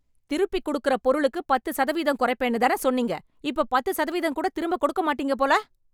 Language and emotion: Tamil, angry